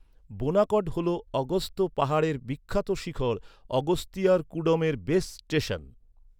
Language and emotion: Bengali, neutral